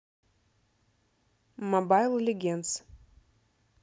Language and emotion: Russian, neutral